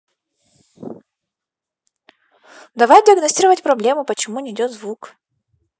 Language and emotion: Russian, angry